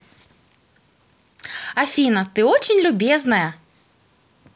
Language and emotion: Russian, positive